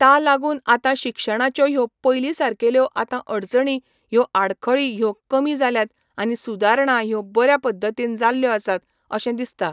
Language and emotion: Goan Konkani, neutral